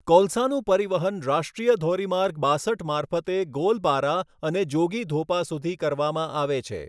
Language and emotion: Gujarati, neutral